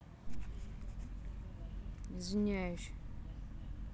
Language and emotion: Russian, neutral